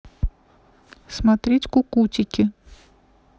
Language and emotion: Russian, neutral